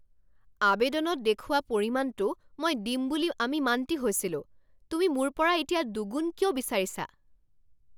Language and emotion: Assamese, angry